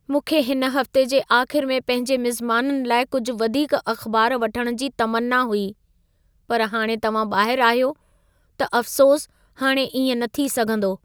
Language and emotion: Sindhi, sad